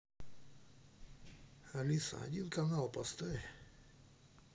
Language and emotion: Russian, neutral